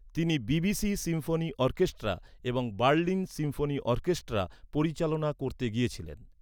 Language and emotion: Bengali, neutral